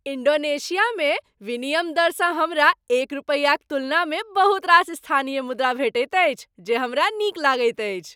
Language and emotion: Maithili, happy